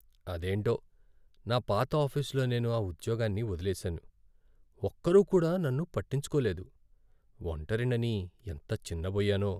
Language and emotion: Telugu, sad